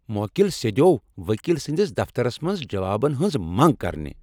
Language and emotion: Kashmiri, angry